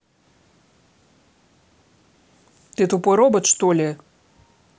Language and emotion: Russian, angry